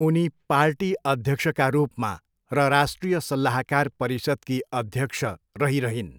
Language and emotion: Nepali, neutral